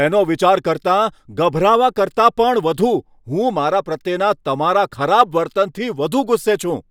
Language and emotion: Gujarati, angry